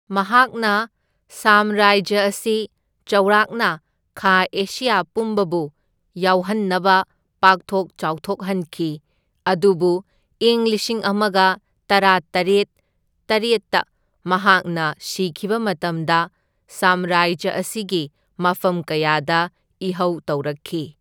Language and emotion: Manipuri, neutral